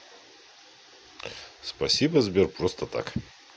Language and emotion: Russian, neutral